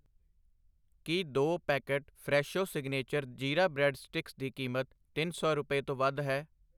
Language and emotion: Punjabi, neutral